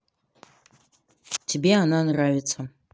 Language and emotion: Russian, neutral